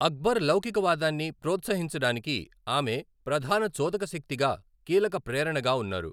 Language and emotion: Telugu, neutral